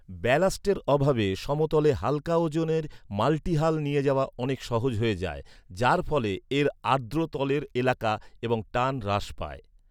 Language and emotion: Bengali, neutral